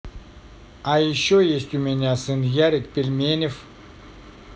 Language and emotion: Russian, neutral